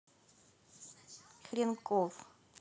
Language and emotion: Russian, neutral